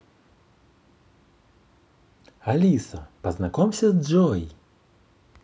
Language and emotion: Russian, positive